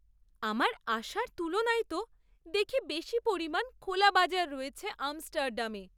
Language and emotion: Bengali, surprised